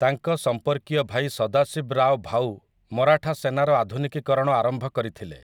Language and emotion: Odia, neutral